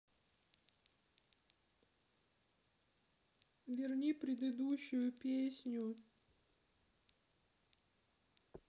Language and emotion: Russian, sad